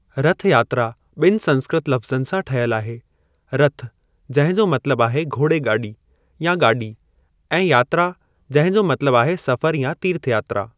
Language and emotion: Sindhi, neutral